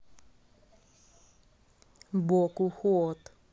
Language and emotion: Russian, neutral